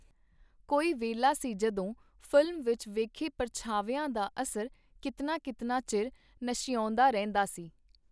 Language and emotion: Punjabi, neutral